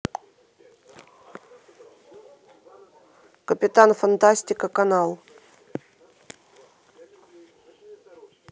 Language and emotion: Russian, neutral